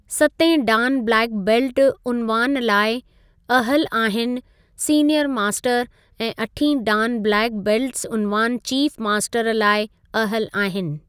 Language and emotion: Sindhi, neutral